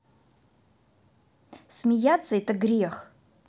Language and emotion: Russian, angry